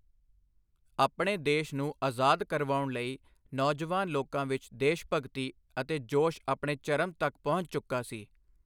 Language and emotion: Punjabi, neutral